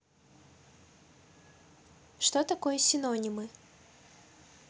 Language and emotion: Russian, neutral